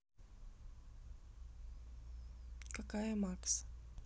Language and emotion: Russian, neutral